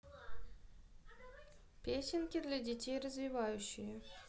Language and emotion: Russian, neutral